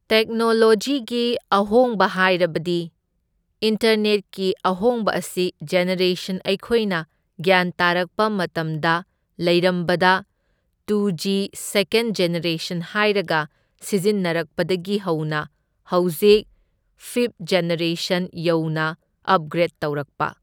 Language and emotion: Manipuri, neutral